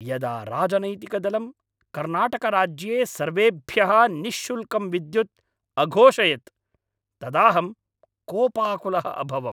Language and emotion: Sanskrit, angry